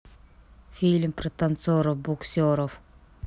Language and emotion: Russian, neutral